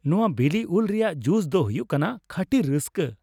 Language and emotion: Santali, happy